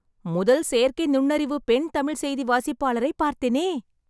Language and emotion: Tamil, happy